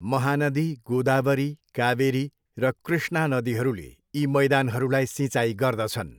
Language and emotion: Nepali, neutral